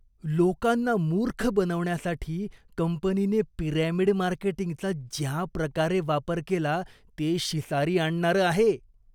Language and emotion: Marathi, disgusted